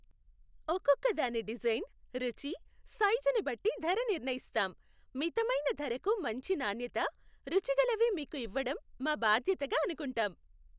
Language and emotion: Telugu, happy